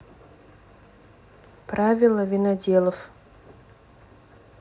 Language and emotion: Russian, neutral